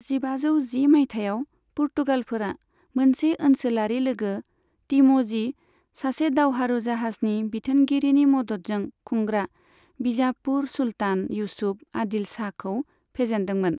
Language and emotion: Bodo, neutral